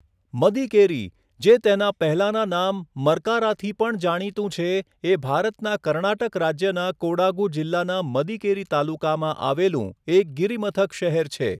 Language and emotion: Gujarati, neutral